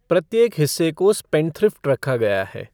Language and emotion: Hindi, neutral